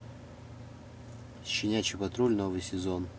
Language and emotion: Russian, neutral